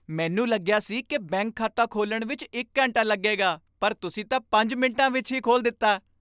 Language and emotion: Punjabi, happy